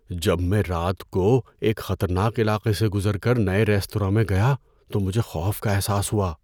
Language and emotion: Urdu, fearful